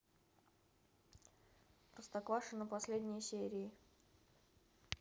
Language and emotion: Russian, neutral